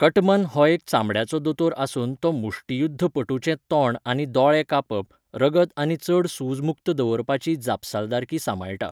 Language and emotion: Goan Konkani, neutral